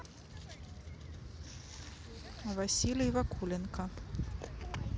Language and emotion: Russian, neutral